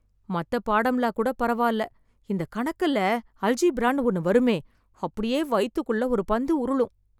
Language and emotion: Tamil, fearful